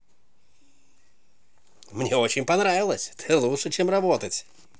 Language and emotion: Russian, positive